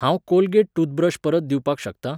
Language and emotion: Goan Konkani, neutral